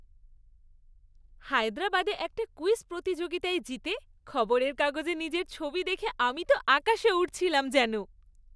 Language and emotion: Bengali, happy